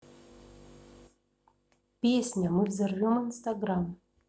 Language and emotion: Russian, neutral